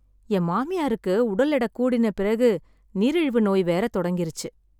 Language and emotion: Tamil, sad